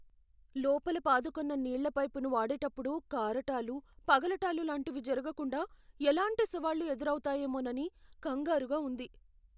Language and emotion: Telugu, fearful